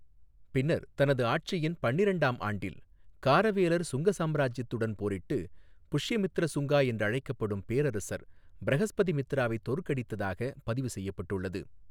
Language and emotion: Tamil, neutral